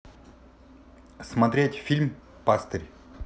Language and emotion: Russian, neutral